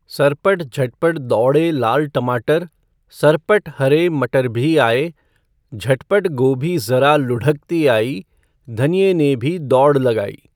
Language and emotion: Hindi, neutral